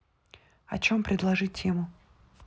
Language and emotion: Russian, neutral